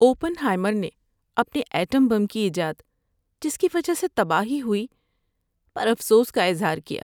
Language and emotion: Urdu, sad